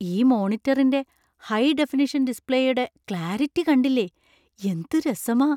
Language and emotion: Malayalam, surprised